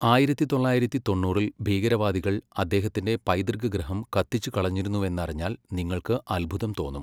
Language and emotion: Malayalam, neutral